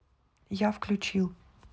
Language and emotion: Russian, neutral